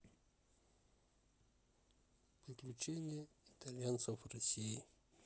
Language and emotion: Russian, neutral